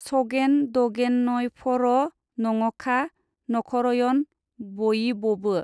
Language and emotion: Bodo, neutral